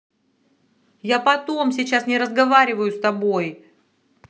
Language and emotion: Russian, angry